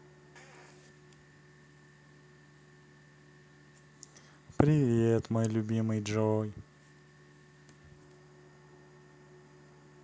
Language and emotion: Russian, positive